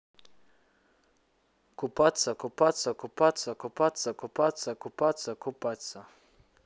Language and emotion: Russian, neutral